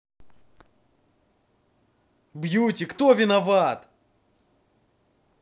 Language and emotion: Russian, angry